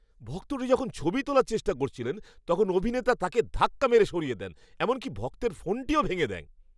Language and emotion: Bengali, angry